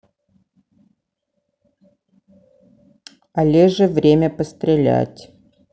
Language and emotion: Russian, neutral